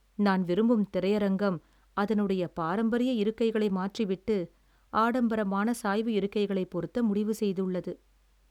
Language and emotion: Tamil, sad